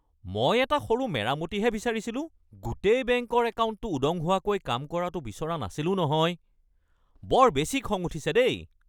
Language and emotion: Assamese, angry